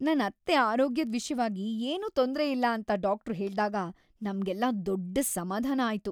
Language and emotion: Kannada, happy